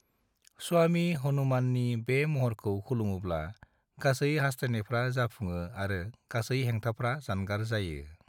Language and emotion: Bodo, neutral